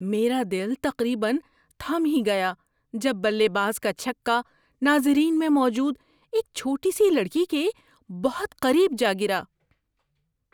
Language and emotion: Urdu, surprised